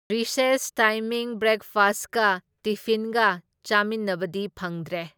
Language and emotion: Manipuri, neutral